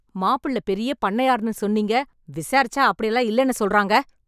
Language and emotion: Tamil, angry